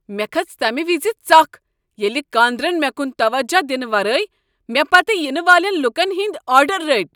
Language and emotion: Kashmiri, angry